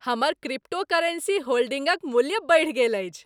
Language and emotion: Maithili, happy